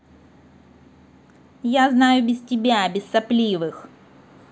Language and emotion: Russian, angry